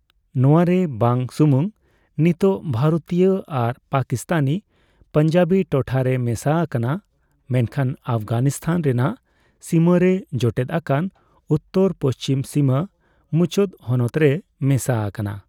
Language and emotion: Santali, neutral